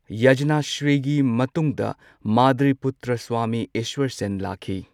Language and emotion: Manipuri, neutral